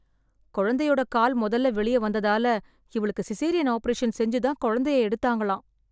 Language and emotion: Tamil, sad